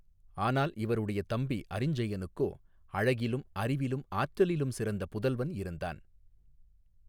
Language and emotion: Tamil, neutral